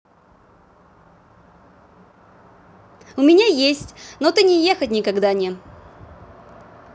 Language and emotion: Russian, positive